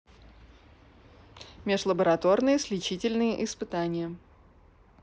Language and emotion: Russian, neutral